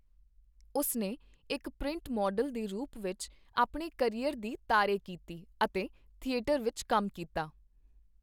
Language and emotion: Punjabi, neutral